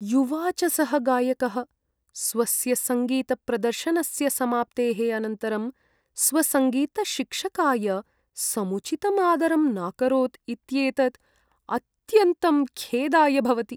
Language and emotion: Sanskrit, sad